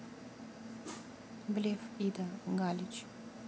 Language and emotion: Russian, neutral